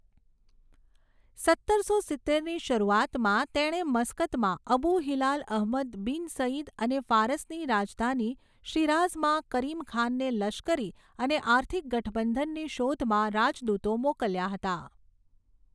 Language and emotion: Gujarati, neutral